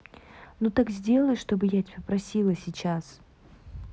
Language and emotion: Russian, angry